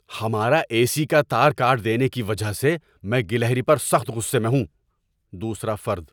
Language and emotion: Urdu, angry